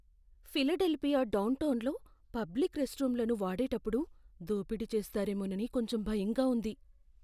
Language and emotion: Telugu, fearful